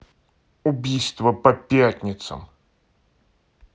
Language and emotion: Russian, angry